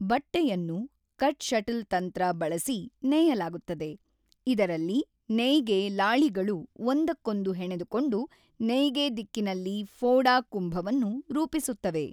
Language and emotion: Kannada, neutral